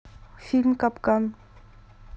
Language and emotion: Russian, neutral